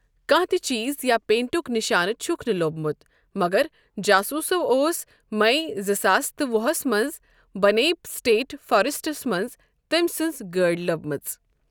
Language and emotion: Kashmiri, neutral